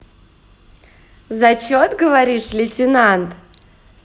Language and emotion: Russian, positive